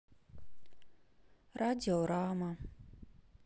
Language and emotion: Russian, sad